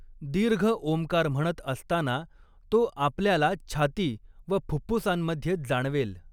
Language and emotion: Marathi, neutral